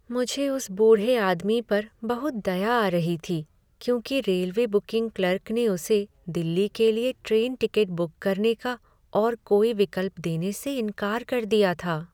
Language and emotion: Hindi, sad